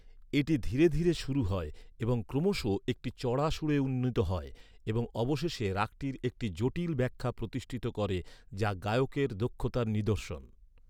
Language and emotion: Bengali, neutral